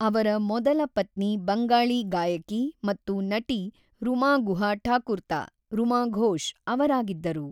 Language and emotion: Kannada, neutral